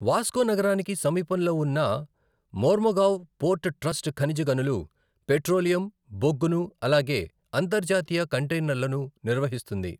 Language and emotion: Telugu, neutral